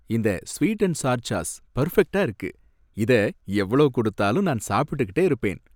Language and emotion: Tamil, happy